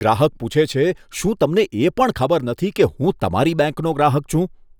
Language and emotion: Gujarati, disgusted